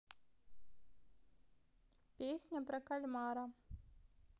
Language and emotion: Russian, neutral